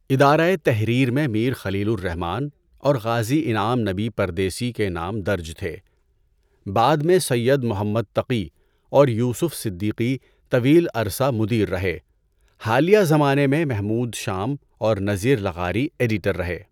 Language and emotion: Urdu, neutral